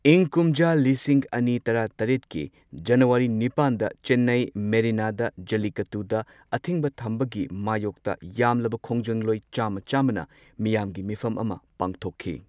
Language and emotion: Manipuri, neutral